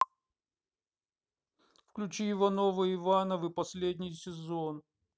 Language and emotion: Russian, neutral